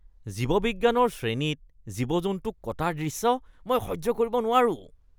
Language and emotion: Assamese, disgusted